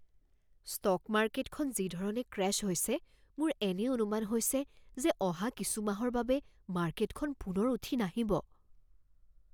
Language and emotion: Assamese, fearful